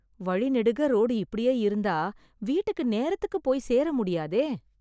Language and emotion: Tamil, sad